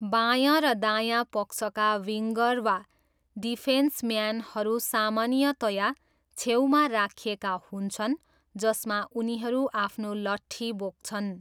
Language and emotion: Nepali, neutral